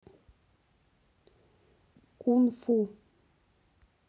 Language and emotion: Russian, neutral